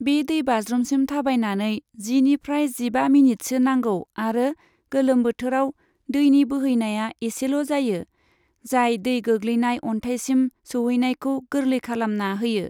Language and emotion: Bodo, neutral